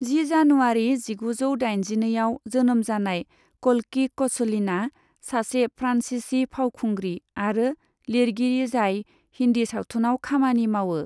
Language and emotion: Bodo, neutral